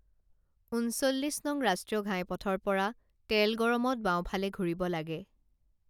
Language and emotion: Assamese, neutral